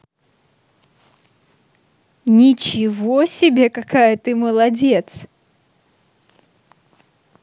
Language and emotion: Russian, positive